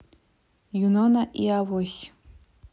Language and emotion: Russian, neutral